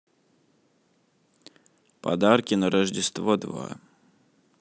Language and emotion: Russian, neutral